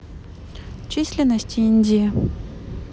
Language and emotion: Russian, neutral